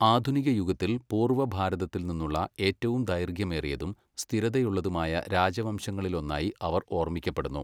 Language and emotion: Malayalam, neutral